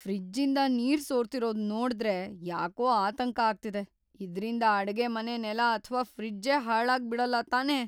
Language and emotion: Kannada, fearful